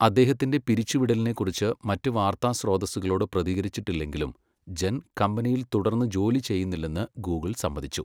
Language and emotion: Malayalam, neutral